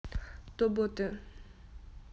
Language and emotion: Russian, neutral